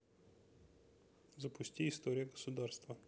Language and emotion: Russian, neutral